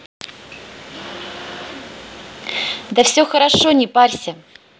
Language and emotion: Russian, positive